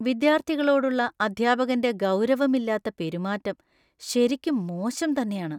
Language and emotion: Malayalam, disgusted